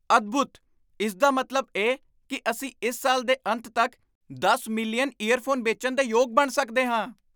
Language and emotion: Punjabi, surprised